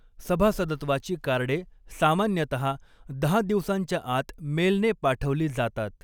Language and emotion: Marathi, neutral